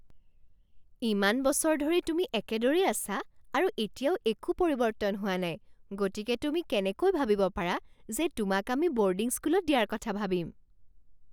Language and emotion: Assamese, surprised